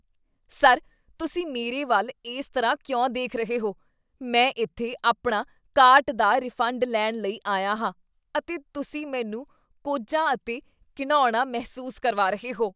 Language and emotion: Punjabi, disgusted